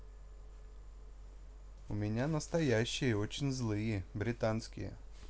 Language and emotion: Russian, neutral